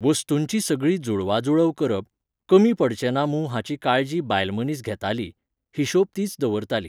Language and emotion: Goan Konkani, neutral